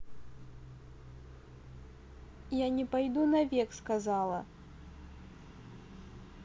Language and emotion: Russian, neutral